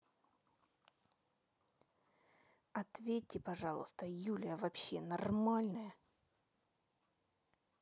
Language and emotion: Russian, angry